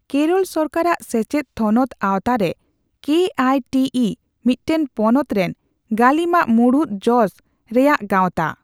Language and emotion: Santali, neutral